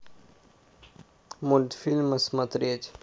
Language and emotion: Russian, neutral